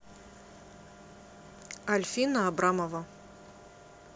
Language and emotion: Russian, neutral